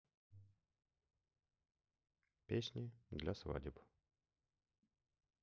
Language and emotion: Russian, sad